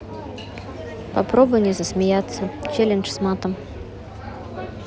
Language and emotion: Russian, neutral